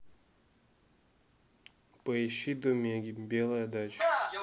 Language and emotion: Russian, neutral